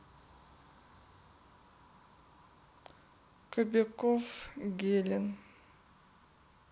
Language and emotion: Russian, sad